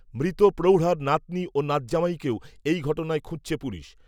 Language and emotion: Bengali, neutral